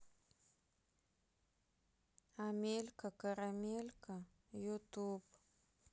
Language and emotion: Russian, sad